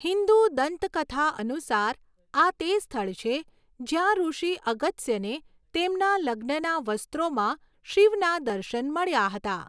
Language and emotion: Gujarati, neutral